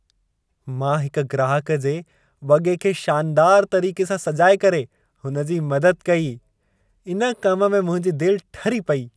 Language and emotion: Sindhi, happy